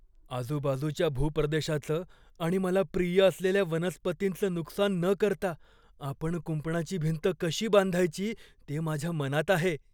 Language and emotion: Marathi, fearful